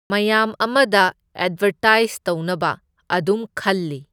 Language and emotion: Manipuri, neutral